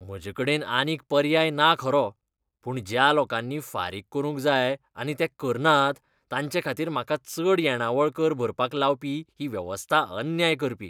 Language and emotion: Goan Konkani, disgusted